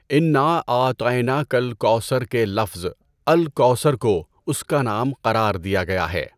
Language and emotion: Urdu, neutral